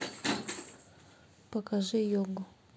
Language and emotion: Russian, neutral